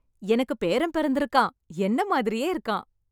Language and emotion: Tamil, happy